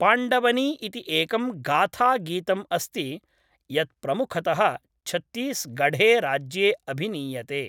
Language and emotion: Sanskrit, neutral